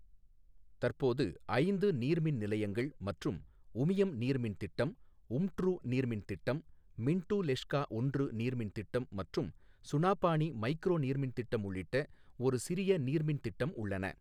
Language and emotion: Tamil, neutral